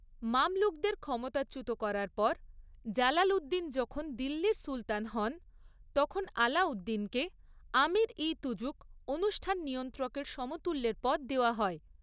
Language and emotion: Bengali, neutral